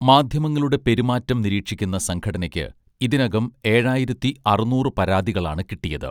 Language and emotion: Malayalam, neutral